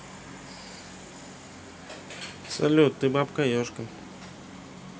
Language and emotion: Russian, neutral